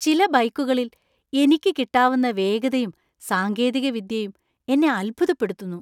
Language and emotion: Malayalam, surprised